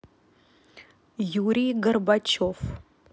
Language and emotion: Russian, neutral